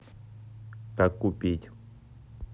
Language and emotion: Russian, neutral